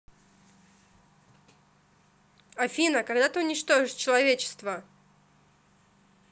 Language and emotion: Russian, neutral